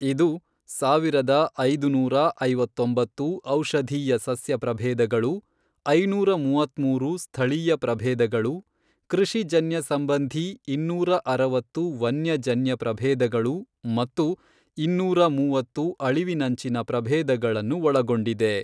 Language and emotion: Kannada, neutral